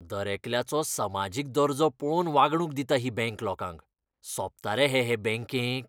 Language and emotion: Goan Konkani, disgusted